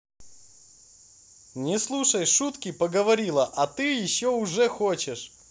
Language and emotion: Russian, positive